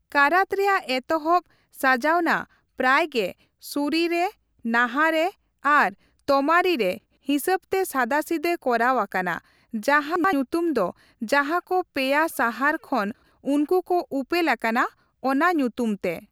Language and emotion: Santali, neutral